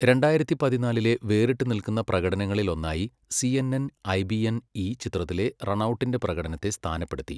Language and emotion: Malayalam, neutral